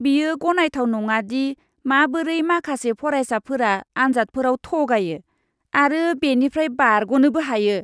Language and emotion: Bodo, disgusted